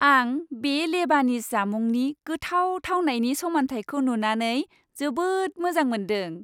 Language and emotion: Bodo, happy